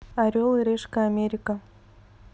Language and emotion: Russian, neutral